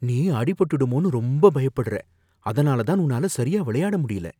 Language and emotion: Tamil, fearful